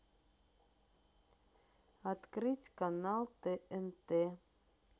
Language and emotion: Russian, neutral